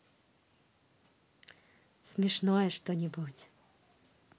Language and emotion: Russian, positive